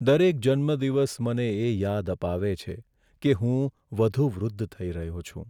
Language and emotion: Gujarati, sad